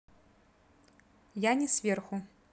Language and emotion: Russian, neutral